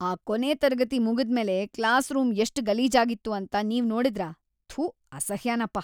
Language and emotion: Kannada, disgusted